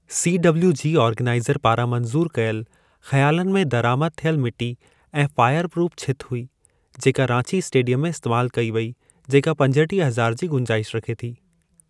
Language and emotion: Sindhi, neutral